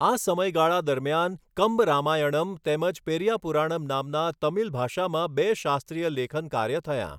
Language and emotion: Gujarati, neutral